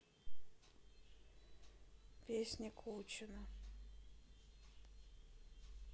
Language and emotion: Russian, neutral